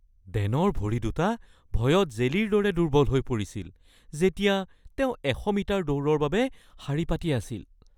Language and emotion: Assamese, fearful